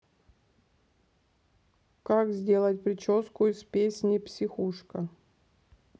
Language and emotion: Russian, neutral